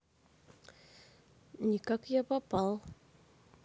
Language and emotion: Russian, neutral